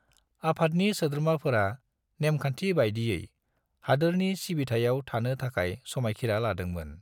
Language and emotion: Bodo, neutral